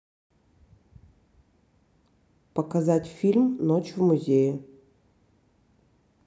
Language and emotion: Russian, neutral